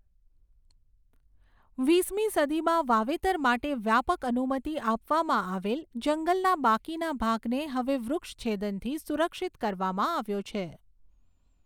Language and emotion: Gujarati, neutral